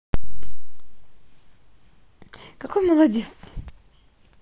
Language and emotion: Russian, positive